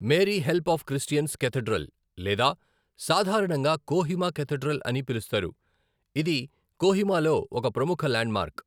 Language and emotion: Telugu, neutral